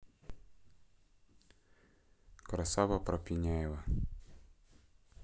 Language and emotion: Russian, neutral